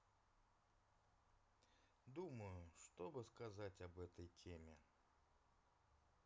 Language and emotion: Russian, neutral